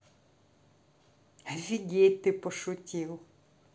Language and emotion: Russian, neutral